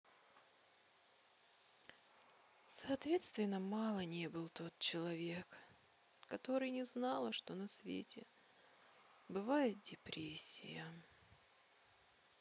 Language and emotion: Russian, sad